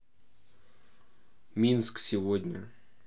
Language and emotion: Russian, neutral